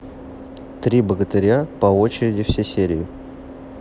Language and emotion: Russian, neutral